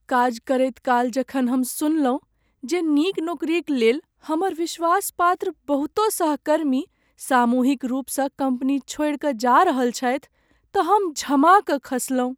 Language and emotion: Maithili, sad